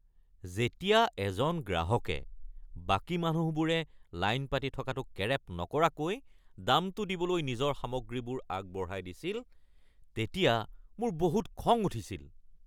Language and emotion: Assamese, angry